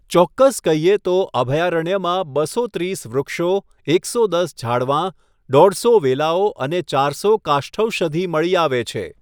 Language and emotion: Gujarati, neutral